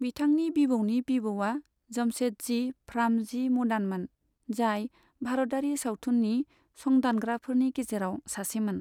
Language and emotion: Bodo, neutral